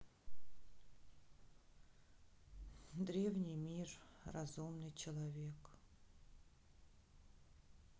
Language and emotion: Russian, sad